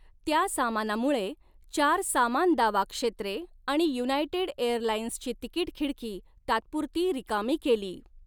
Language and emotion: Marathi, neutral